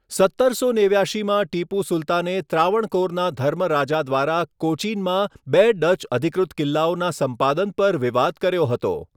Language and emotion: Gujarati, neutral